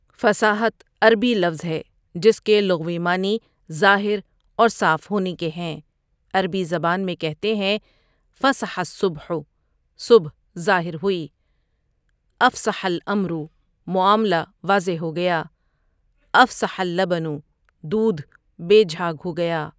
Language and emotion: Urdu, neutral